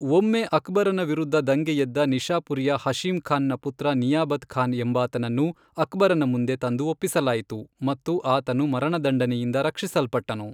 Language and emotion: Kannada, neutral